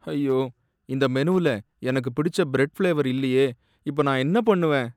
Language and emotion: Tamil, sad